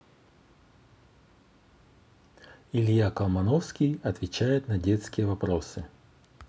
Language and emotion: Russian, neutral